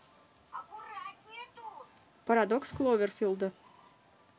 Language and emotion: Russian, neutral